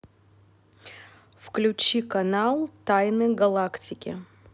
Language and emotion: Russian, neutral